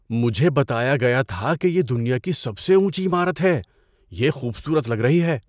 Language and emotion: Urdu, surprised